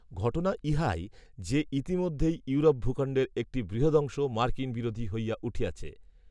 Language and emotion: Bengali, neutral